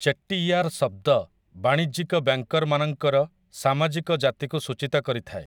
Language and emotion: Odia, neutral